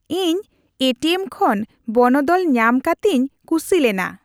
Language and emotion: Santali, happy